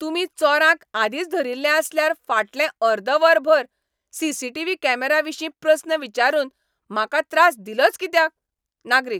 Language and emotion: Goan Konkani, angry